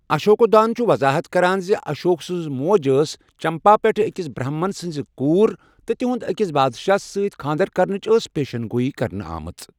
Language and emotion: Kashmiri, neutral